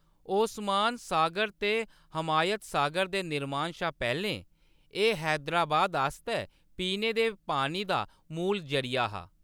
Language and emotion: Dogri, neutral